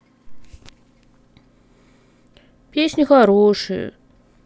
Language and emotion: Russian, sad